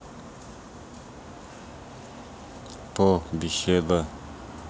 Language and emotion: Russian, neutral